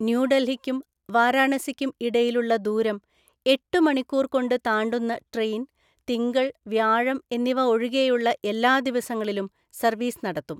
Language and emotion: Malayalam, neutral